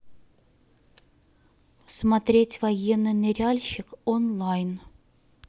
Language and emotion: Russian, neutral